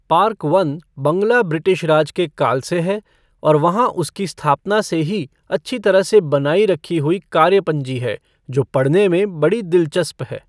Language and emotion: Hindi, neutral